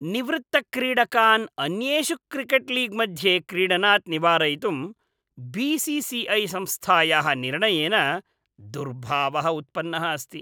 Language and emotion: Sanskrit, disgusted